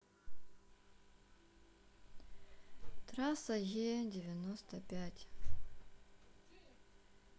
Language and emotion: Russian, sad